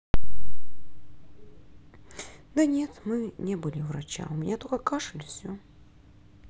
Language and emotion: Russian, sad